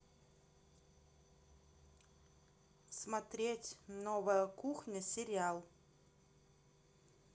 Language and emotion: Russian, neutral